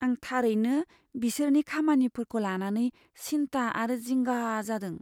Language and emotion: Bodo, fearful